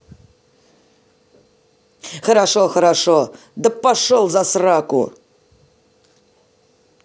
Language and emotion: Russian, angry